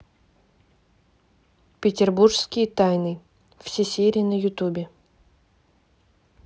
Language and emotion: Russian, neutral